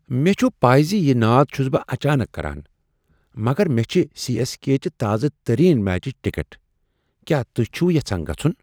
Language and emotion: Kashmiri, surprised